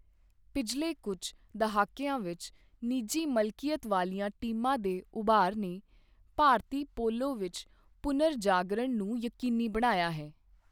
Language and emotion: Punjabi, neutral